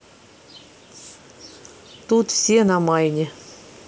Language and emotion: Russian, neutral